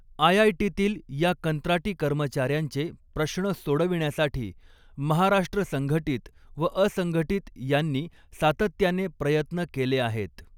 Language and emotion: Marathi, neutral